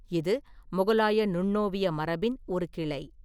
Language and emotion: Tamil, neutral